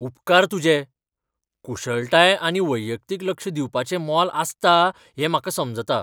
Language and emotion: Goan Konkani, surprised